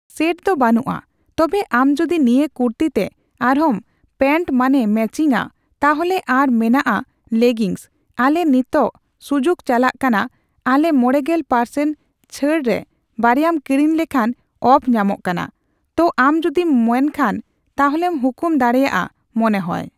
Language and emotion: Santali, neutral